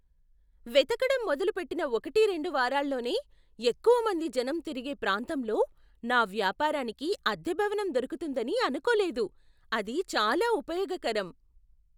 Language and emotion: Telugu, surprised